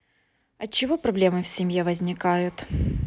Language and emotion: Russian, neutral